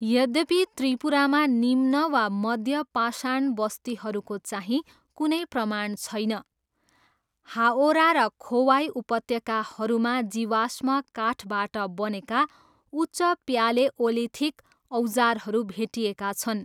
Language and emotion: Nepali, neutral